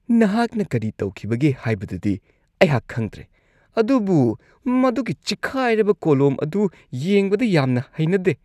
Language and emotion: Manipuri, disgusted